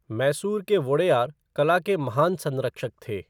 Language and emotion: Hindi, neutral